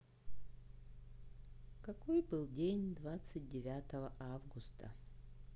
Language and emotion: Russian, sad